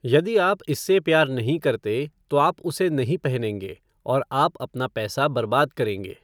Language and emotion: Hindi, neutral